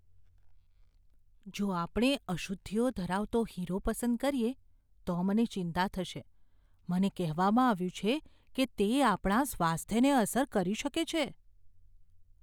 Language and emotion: Gujarati, fearful